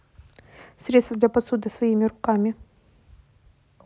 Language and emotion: Russian, neutral